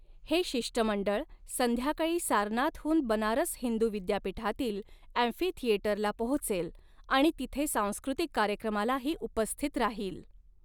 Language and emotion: Marathi, neutral